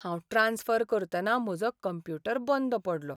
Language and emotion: Goan Konkani, sad